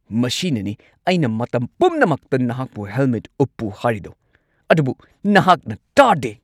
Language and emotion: Manipuri, angry